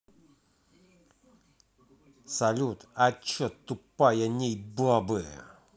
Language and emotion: Russian, angry